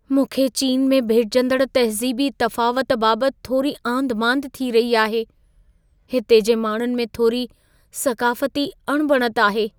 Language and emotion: Sindhi, fearful